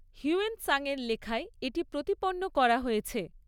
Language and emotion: Bengali, neutral